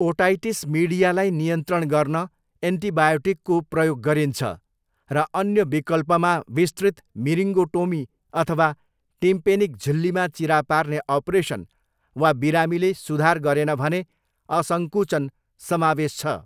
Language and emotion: Nepali, neutral